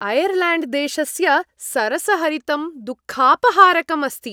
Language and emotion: Sanskrit, happy